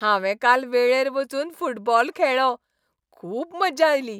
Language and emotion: Goan Konkani, happy